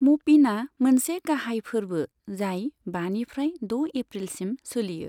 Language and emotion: Bodo, neutral